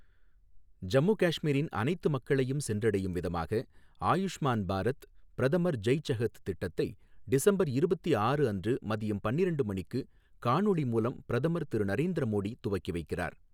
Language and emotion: Tamil, neutral